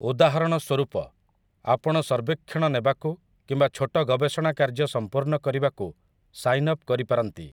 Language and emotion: Odia, neutral